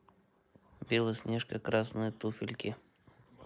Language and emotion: Russian, neutral